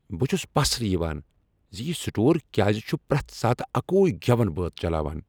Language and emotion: Kashmiri, angry